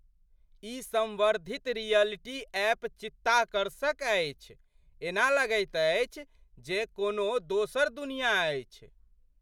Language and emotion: Maithili, surprised